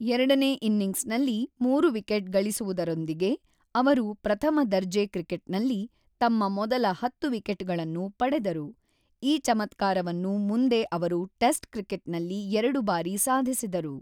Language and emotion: Kannada, neutral